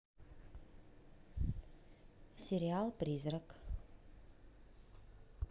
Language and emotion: Russian, neutral